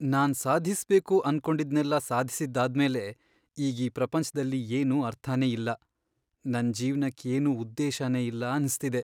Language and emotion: Kannada, sad